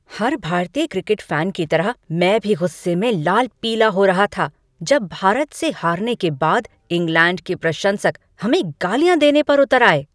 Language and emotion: Hindi, angry